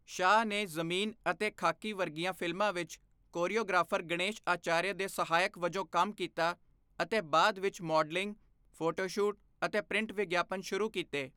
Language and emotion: Punjabi, neutral